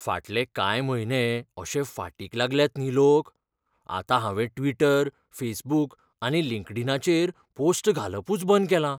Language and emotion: Goan Konkani, fearful